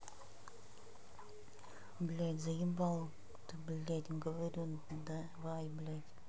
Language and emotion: Russian, angry